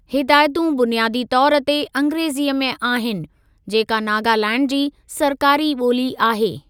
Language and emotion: Sindhi, neutral